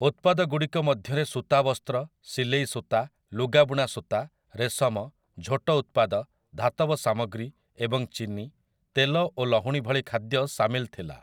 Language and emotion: Odia, neutral